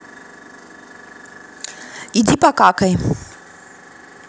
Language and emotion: Russian, angry